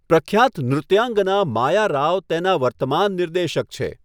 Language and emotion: Gujarati, neutral